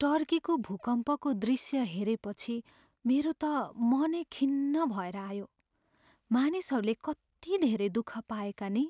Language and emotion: Nepali, sad